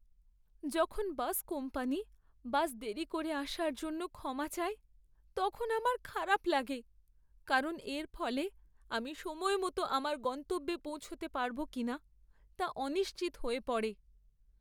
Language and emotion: Bengali, sad